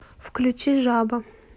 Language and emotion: Russian, neutral